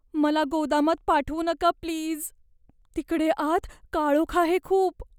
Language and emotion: Marathi, fearful